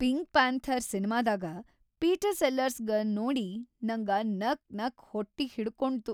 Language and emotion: Kannada, happy